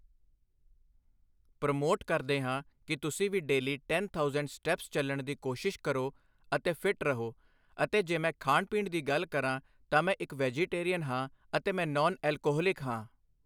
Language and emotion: Punjabi, neutral